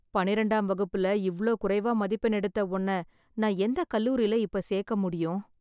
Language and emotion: Tamil, sad